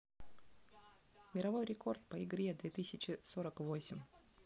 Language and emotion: Russian, neutral